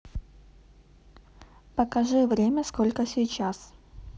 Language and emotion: Russian, neutral